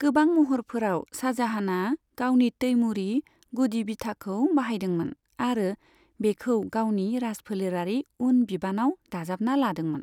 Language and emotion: Bodo, neutral